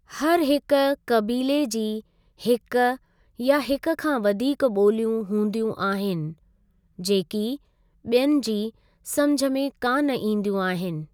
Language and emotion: Sindhi, neutral